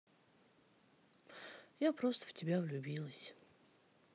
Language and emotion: Russian, sad